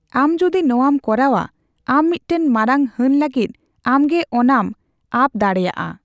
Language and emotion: Santali, neutral